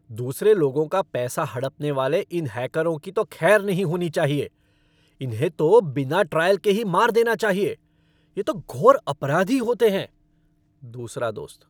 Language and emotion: Hindi, angry